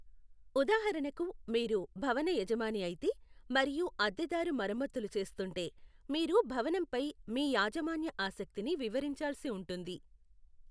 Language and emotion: Telugu, neutral